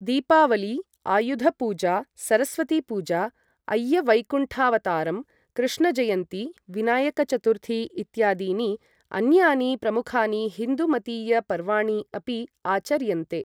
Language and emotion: Sanskrit, neutral